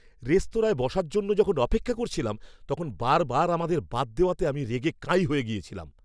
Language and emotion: Bengali, angry